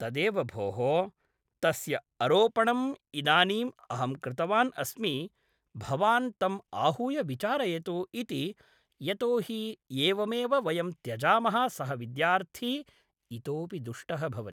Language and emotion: Sanskrit, neutral